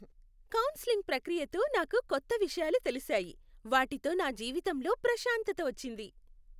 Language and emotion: Telugu, happy